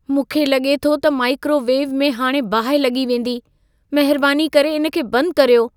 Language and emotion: Sindhi, fearful